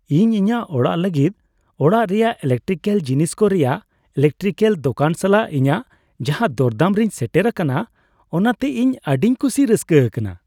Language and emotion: Santali, happy